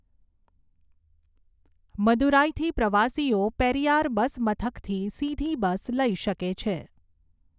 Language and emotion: Gujarati, neutral